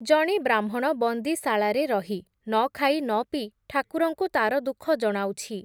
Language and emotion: Odia, neutral